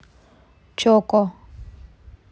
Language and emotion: Russian, neutral